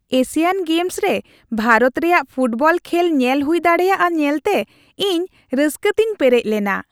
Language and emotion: Santali, happy